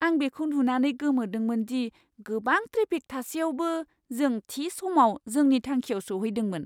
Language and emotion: Bodo, surprised